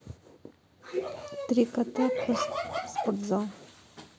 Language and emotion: Russian, neutral